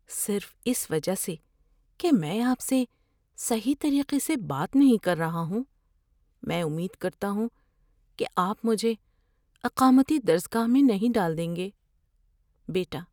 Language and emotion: Urdu, fearful